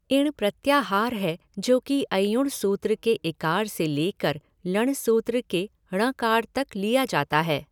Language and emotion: Hindi, neutral